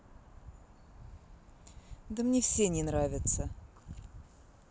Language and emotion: Russian, neutral